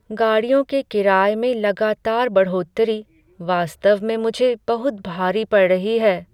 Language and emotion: Hindi, sad